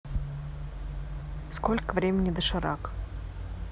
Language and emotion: Russian, neutral